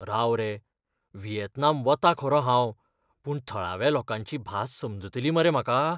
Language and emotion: Goan Konkani, fearful